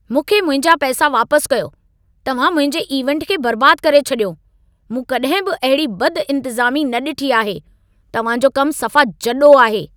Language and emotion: Sindhi, angry